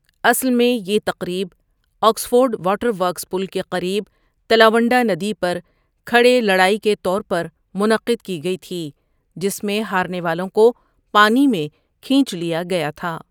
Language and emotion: Urdu, neutral